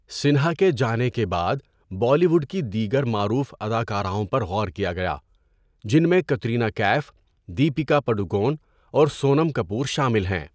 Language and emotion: Urdu, neutral